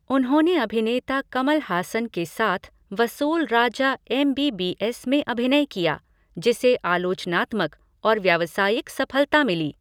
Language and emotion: Hindi, neutral